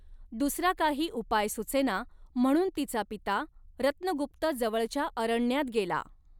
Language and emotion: Marathi, neutral